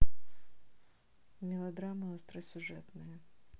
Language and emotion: Russian, neutral